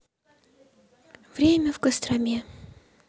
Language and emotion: Russian, sad